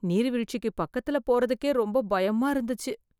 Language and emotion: Tamil, fearful